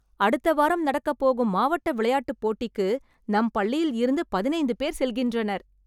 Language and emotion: Tamil, happy